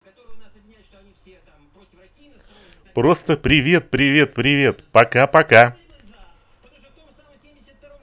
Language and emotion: Russian, positive